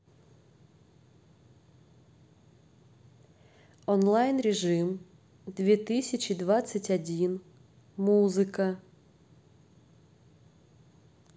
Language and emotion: Russian, neutral